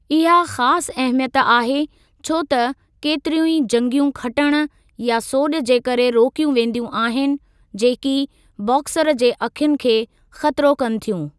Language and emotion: Sindhi, neutral